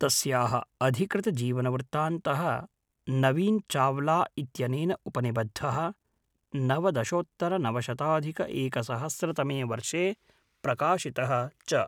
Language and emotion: Sanskrit, neutral